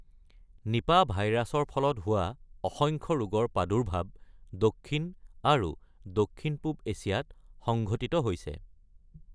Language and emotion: Assamese, neutral